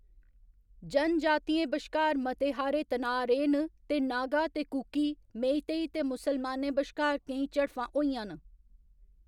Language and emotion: Dogri, neutral